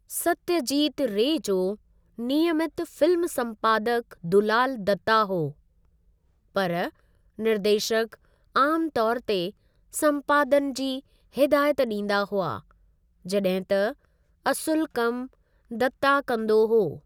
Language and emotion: Sindhi, neutral